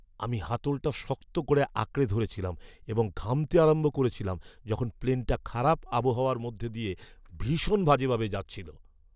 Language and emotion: Bengali, fearful